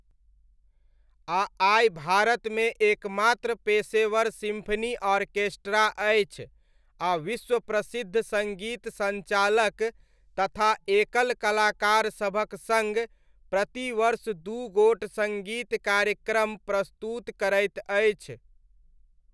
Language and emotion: Maithili, neutral